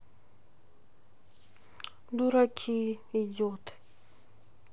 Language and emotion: Russian, sad